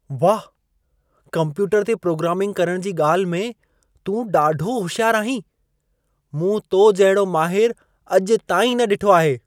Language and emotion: Sindhi, surprised